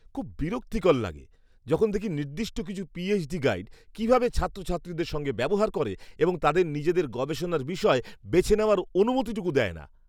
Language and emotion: Bengali, disgusted